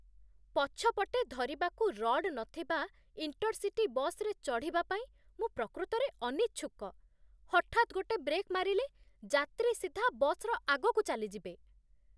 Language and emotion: Odia, disgusted